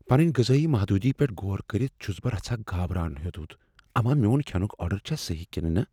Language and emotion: Kashmiri, fearful